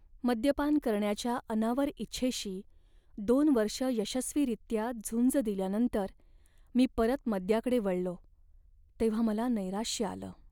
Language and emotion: Marathi, sad